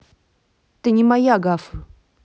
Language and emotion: Russian, neutral